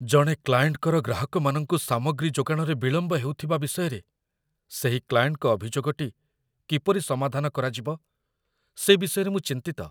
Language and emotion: Odia, fearful